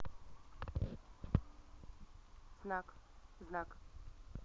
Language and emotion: Russian, neutral